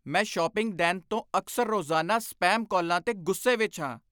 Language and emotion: Punjabi, angry